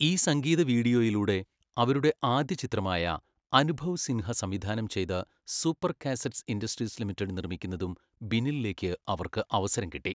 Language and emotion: Malayalam, neutral